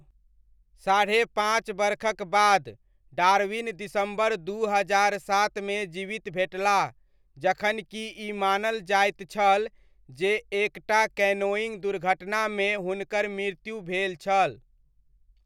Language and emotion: Maithili, neutral